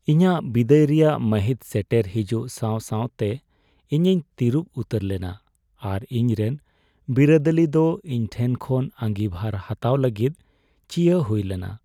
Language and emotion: Santali, sad